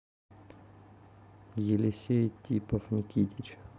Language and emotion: Russian, neutral